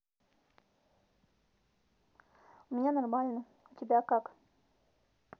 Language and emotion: Russian, neutral